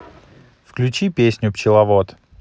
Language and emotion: Russian, neutral